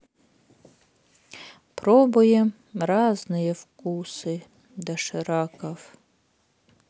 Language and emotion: Russian, sad